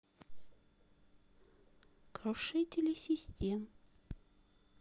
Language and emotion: Russian, neutral